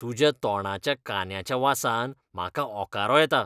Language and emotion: Goan Konkani, disgusted